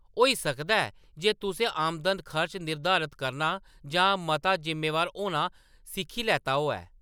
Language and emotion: Dogri, neutral